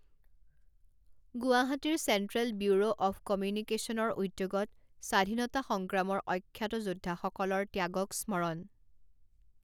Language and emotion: Assamese, neutral